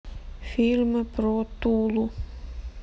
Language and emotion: Russian, sad